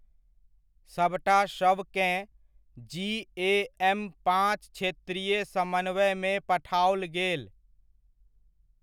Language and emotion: Maithili, neutral